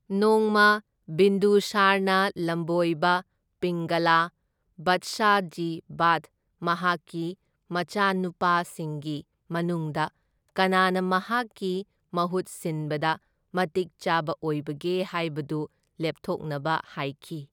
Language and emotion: Manipuri, neutral